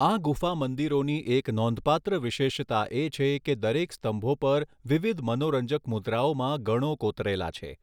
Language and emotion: Gujarati, neutral